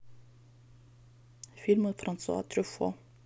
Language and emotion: Russian, neutral